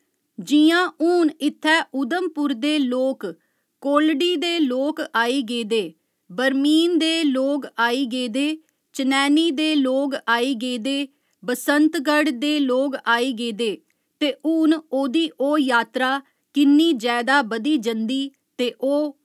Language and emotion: Dogri, neutral